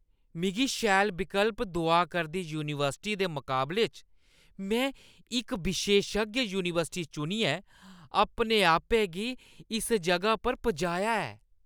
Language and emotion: Dogri, disgusted